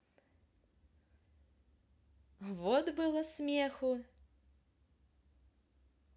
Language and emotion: Russian, positive